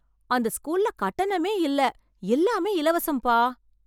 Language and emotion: Tamil, surprised